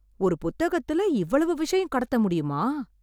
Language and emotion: Tamil, surprised